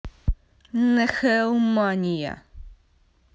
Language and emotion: Russian, neutral